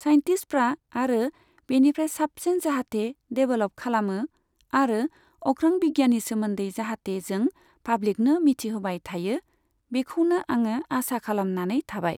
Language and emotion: Bodo, neutral